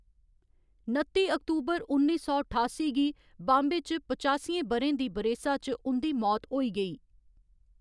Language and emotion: Dogri, neutral